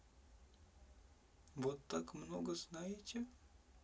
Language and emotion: Russian, neutral